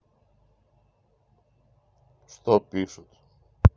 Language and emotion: Russian, neutral